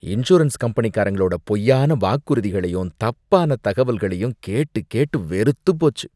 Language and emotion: Tamil, disgusted